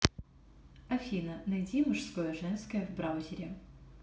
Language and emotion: Russian, neutral